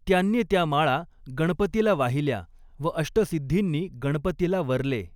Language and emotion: Marathi, neutral